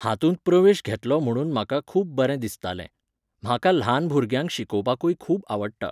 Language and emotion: Goan Konkani, neutral